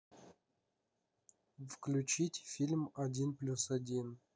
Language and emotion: Russian, neutral